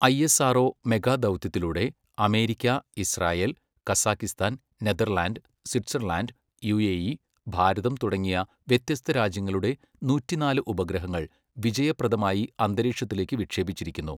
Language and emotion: Malayalam, neutral